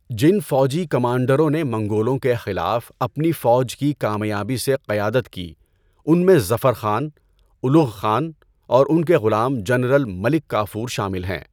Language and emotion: Urdu, neutral